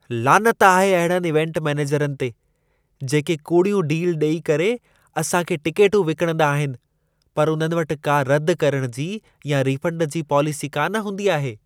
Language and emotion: Sindhi, disgusted